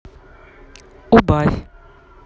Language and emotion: Russian, neutral